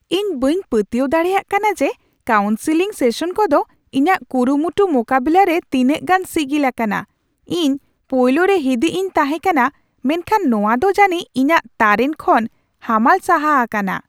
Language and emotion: Santali, surprised